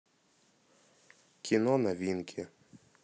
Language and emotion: Russian, neutral